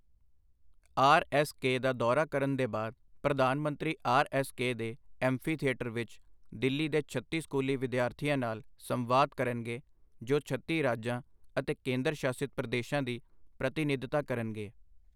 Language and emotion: Punjabi, neutral